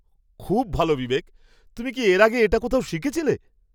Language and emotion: Bengali, surprised